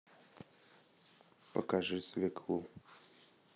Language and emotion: Russian, neutral